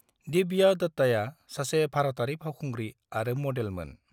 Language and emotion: Bodo, neutral